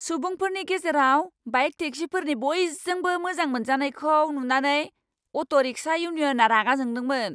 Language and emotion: Bodo, angry